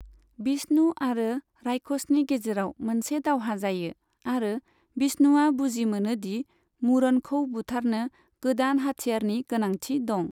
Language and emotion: Bodo, neutral